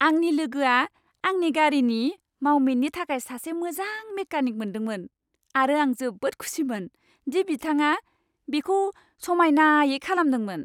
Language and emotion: Bodo, happy